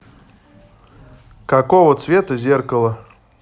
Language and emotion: Russian, neutral